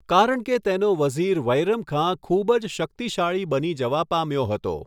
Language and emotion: Gujarati, neutral